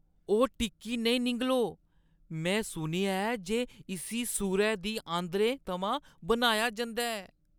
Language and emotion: Dogri, disgusted